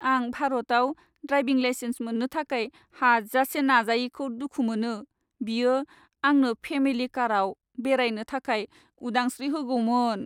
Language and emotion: Bodo, sad